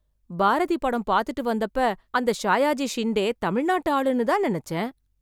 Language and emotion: Tamil, surprised